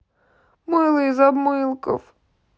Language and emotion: Russian, sad